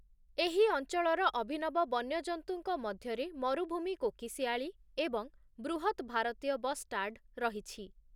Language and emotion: Odia, neutral